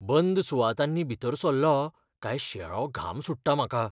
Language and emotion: Goan Konkani, fearful